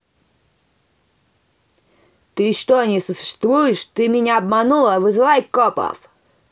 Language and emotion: Russian, angry